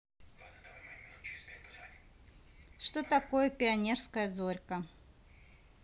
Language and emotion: Russian, neutral